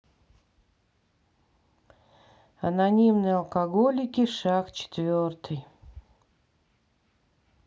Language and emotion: Russian, sad